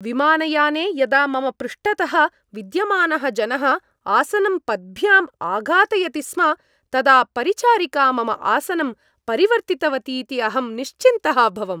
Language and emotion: Sanskrit, happy